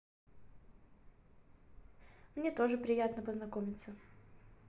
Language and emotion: Russian, positive